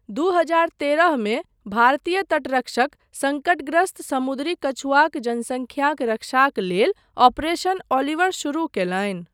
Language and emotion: Maithili, neutral